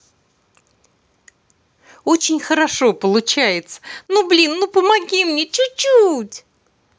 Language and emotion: Russian, positive